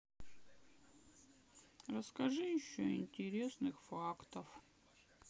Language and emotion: Russian, sad